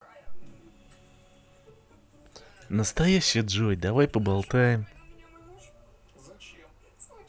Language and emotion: Russian, positive